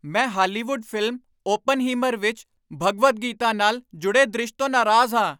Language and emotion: Punjabi, angry